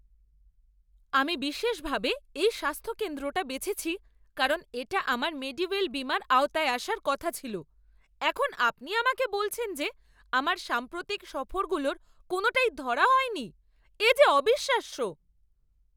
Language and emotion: Bengali, angry